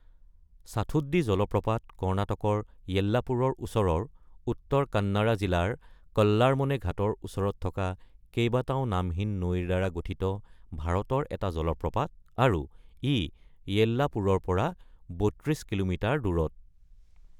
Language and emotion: Assamese, neutral